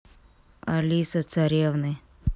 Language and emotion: Russian, neutral